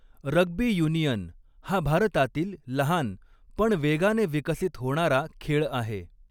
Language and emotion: Marathi, neutral